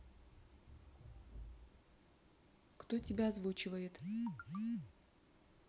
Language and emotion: Russian, neutral